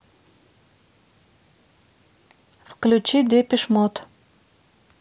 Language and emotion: Russian, neutral